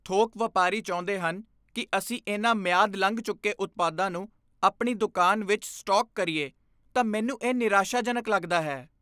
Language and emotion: Punjabi, disgusted